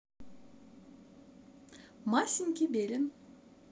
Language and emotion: Russian, positive